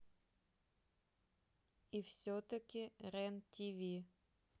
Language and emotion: Russian, neutral